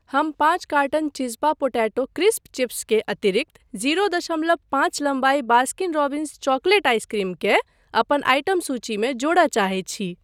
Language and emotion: Maithili, neutral